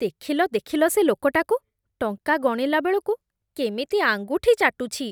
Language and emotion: Odia, disgusted